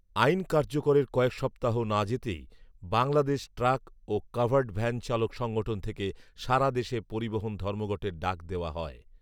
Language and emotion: Bengali, neutral